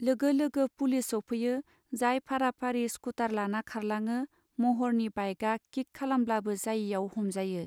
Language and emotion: Bodo, neutral